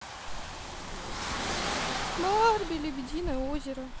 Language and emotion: Russian, sad